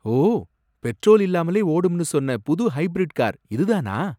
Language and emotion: Tamil, surprised